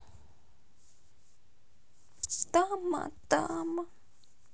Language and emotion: Russian, sad